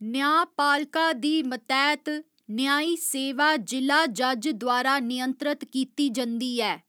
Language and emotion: Dogri, neutral